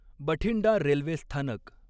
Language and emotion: Marathi, neutral